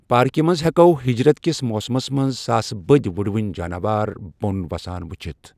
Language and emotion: Kashmiri, neutral